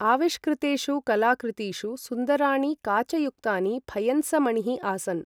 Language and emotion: Sanskrit, neutral